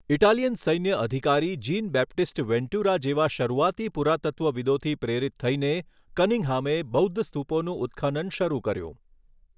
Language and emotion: Gujarati, neutral